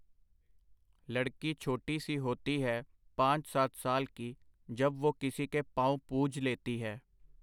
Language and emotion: Punjabi, neutral